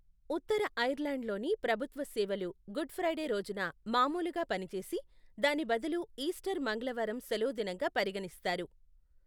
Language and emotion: Telugu, neutral